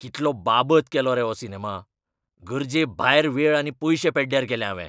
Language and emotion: Goan Konkani, angry